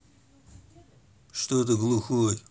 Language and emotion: Russian, neutral